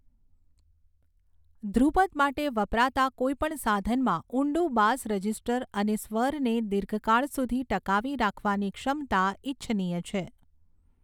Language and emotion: Gujarati, neutral